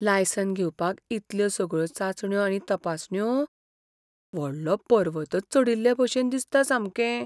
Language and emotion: Goan Konkani, fearful